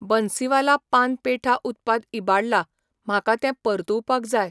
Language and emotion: Goan Konkani, neutral